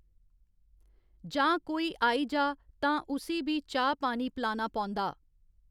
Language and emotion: Dogri, neutral